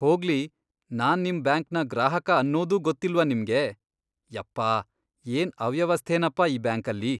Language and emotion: Kannada, disgusted